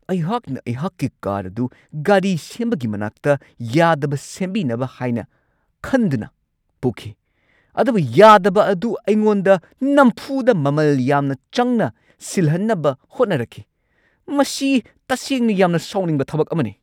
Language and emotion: Manipuri, angry